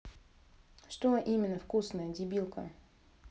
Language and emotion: Russian, angry